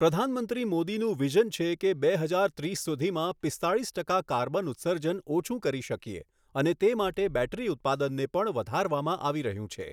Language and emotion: Gujarati, neutral